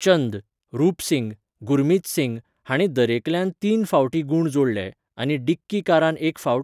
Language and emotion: Goan Konkani, neutral